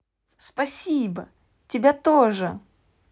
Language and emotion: Russian, positive